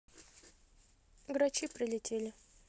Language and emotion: Russian, neutral